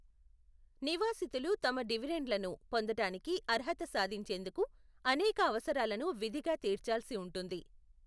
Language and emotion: Telugu, neutral